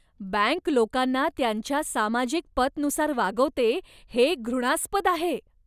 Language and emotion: Marathi, disgusted